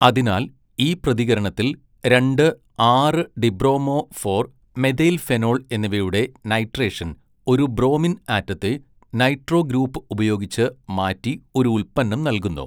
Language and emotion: Malayalam, neutral